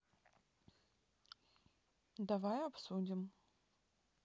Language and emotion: Russian, neutral